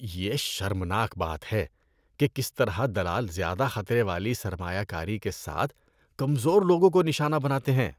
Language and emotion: Urdu, disgusted